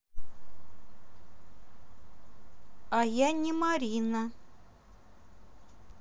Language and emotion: Russian, neutral